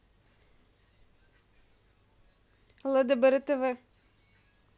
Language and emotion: Russian, neutral